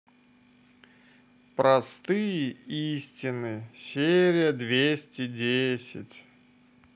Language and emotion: Russian, neutral